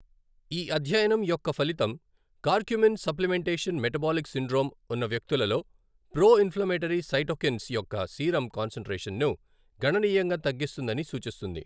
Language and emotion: Telugu, neutral